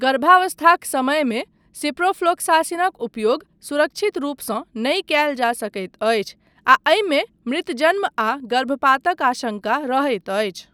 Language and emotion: Maithili, neutral